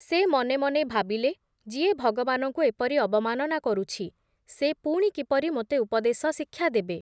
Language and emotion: Odia, neutral